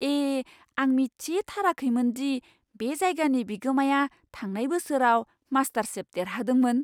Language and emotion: Bodo, surprised